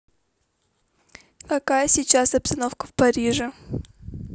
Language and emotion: Russian, neutral